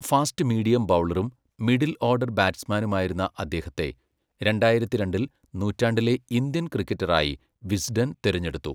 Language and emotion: Malayalam, neutral